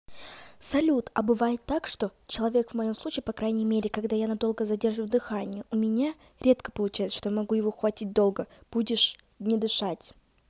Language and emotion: Russian, neutral